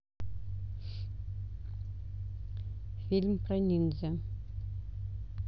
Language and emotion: Russian, neutral